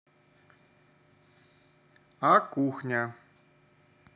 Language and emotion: Russian, neutral